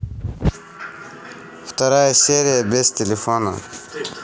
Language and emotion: Russian, neutral